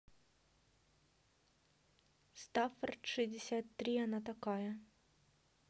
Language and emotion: Russian, neutral